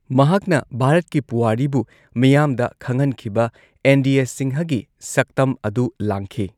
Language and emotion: Manipuri, neutral